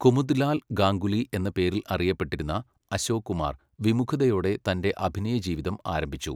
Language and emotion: Malayalam, neutral